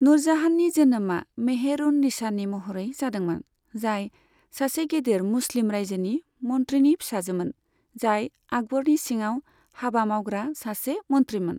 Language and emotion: Bodo, neutral